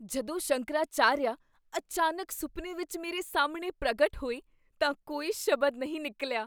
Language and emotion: Punjabi, surprised